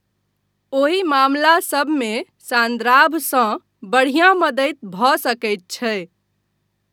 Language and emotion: Maithili, neutral